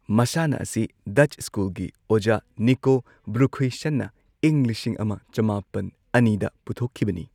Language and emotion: Manipuri, neutral